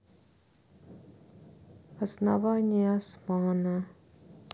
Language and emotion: Russian, sad